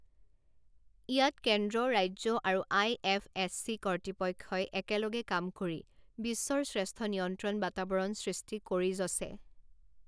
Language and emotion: Assamese, neutral